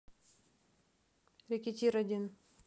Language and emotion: Russian, neutral